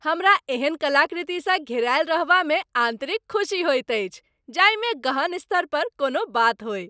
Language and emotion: Maithili, happy